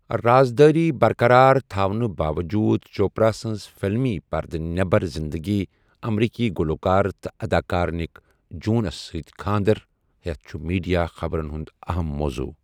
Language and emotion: Kashmiri, neutral